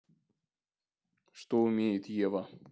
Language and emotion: Russian, neutral